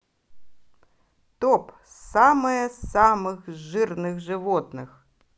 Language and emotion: Russian, positive